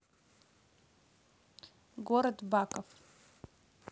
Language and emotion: Russian, neutral